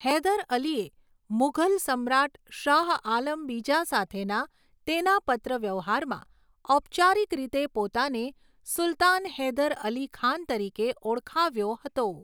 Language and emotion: Gujarati, neutral